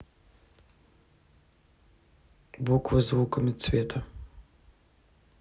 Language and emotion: Russian, neutral